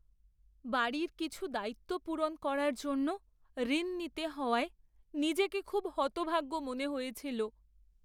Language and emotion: Bengali, sad